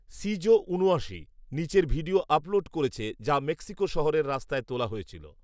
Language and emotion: Bengali, neutral